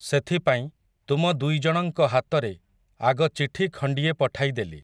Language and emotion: Odia, neutral